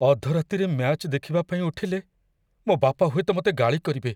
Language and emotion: Odia, fearful